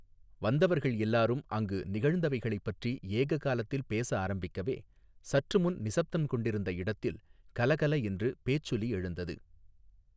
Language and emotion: Tamil, neutral